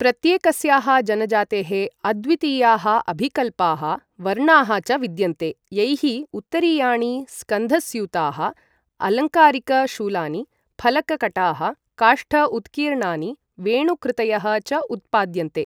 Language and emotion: Sanskrit, neutral